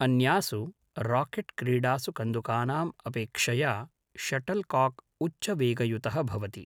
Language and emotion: Sanskrit, neutral